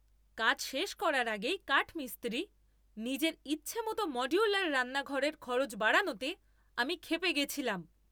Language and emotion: Bengali, angry